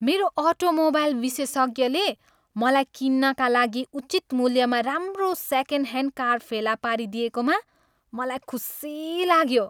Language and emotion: Nepali, happy